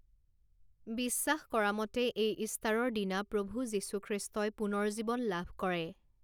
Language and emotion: Assamese, neutral